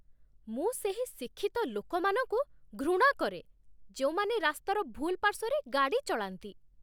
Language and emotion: Odia, disgusted